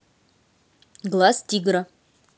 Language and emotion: Russian, neutral